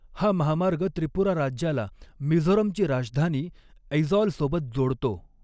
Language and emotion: Marathi, neutral